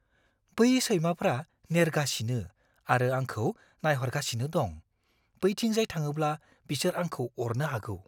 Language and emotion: Bodo, fearful